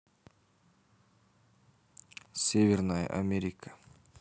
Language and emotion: Russian, neutral